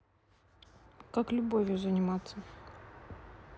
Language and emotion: Russian, neutral